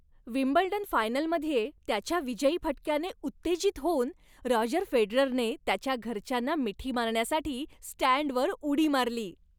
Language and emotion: Marathi, happy